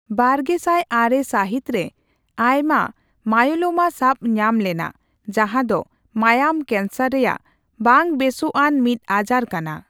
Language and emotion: Santali, neutral